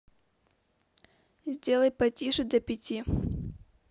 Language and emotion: Russian, neutral